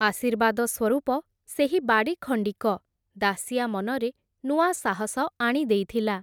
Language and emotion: Odia, neutral